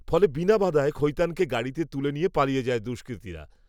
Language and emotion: Bengali, neutral